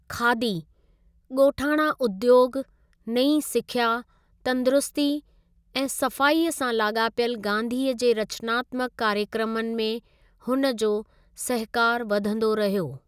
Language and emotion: Sindhi, neutral